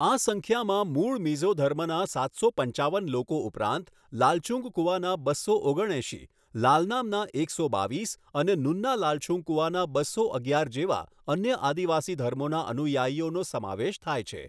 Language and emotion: Gujarati, neutral